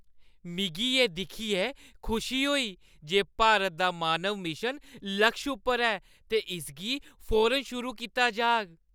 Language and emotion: Dogri, happy